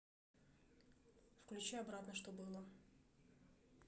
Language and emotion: Russian, neutral